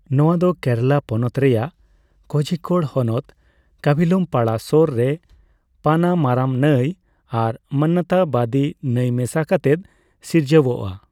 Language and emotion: Santali, neutral